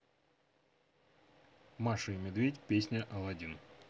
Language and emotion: Russian, neutral